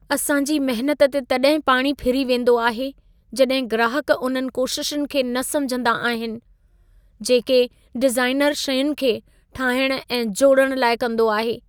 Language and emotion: Sindhi, sad